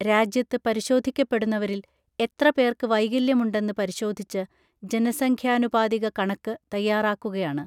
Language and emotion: Malayalam, neutral